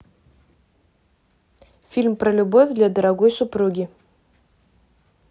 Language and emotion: Russian, neutral